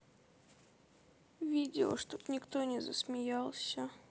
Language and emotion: Russian, sad